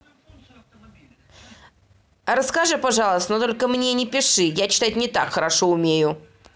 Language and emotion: Russian, neutral